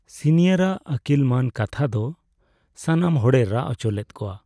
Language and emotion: Santali, sad